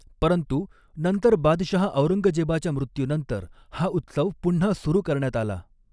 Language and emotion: Marathi, neutral